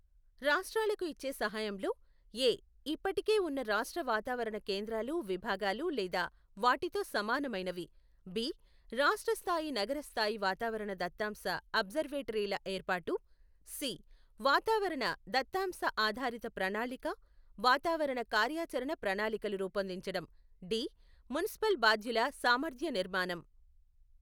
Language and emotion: Telugu, neutral